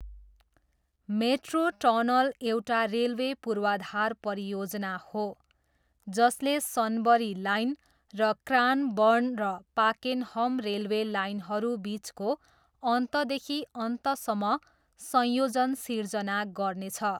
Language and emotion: Nepali, neutral